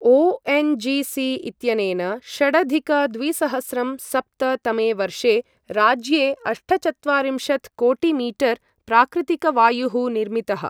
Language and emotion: Sanskrit, neutral